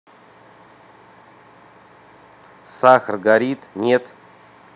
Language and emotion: Russian, neutral